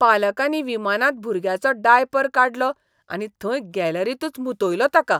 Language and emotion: Goan Konkani, disgusted